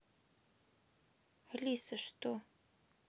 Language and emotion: Russian, sad